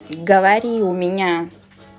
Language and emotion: Russian, neutral